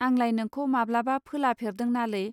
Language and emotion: Bodo, neutral